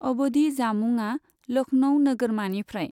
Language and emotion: Bodo, neutral